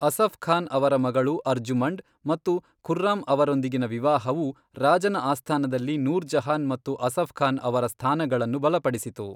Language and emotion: Kannada, neutral